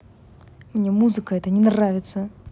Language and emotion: Russian, angry